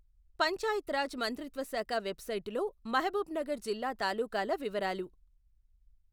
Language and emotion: Telugu, neutral